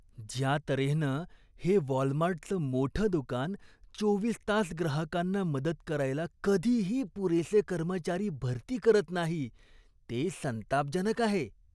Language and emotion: Marathi, disgusted